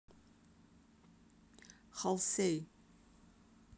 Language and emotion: Russian, neutral